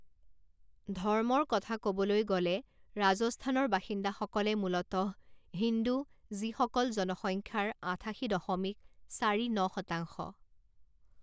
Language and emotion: Assamese, neutral